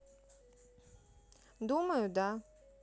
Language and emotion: Russian, neutral